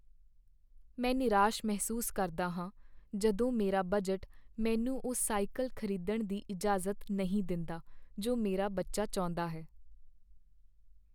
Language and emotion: Punjabi, sad